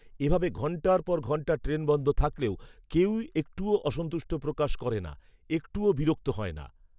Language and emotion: Bengali, neutral